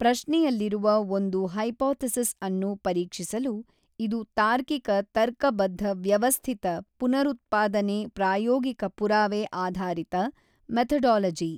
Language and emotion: Kannada, neutral